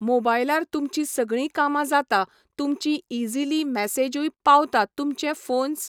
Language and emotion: Goan Konkani, neutral